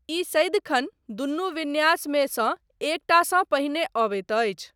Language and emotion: Maithili, neutral